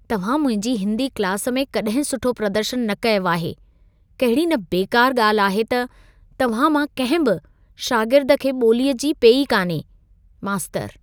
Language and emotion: Sindhi, disgusted